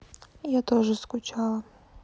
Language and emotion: Russian, sad